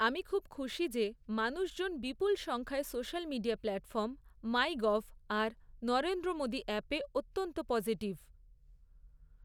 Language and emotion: Bengali, neutral